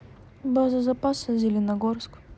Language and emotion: Russian, neutral